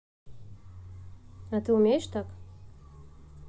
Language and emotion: Russian, neutral